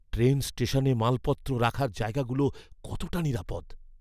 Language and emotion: Bengali, fearful